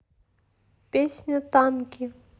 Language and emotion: Russian, neutral